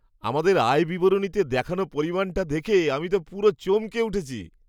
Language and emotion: Bengali, surprised